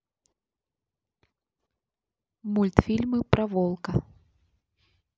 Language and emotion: Russian, neutral